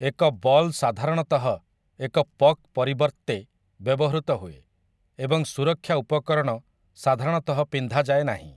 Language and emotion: Odia, neutral